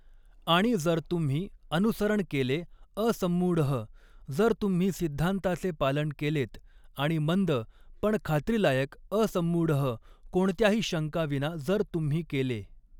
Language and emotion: Marathi, neutral